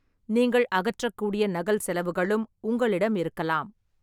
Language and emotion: Tamil, neutral